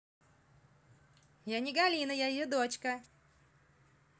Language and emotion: Russian, positive